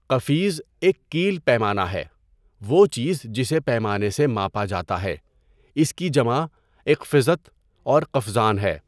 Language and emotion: Urdu, neutral